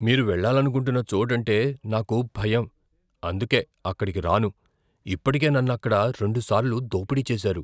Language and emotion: Telugu, fearful